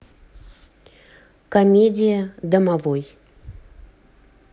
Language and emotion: Russian, neutral